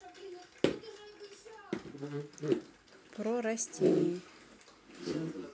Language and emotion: Russian, neutral